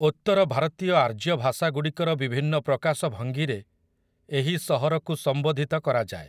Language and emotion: Odia, neutral